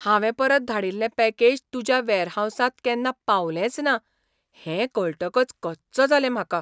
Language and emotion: Goan Konkani, surprised